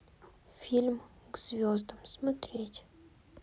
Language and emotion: Russian, sad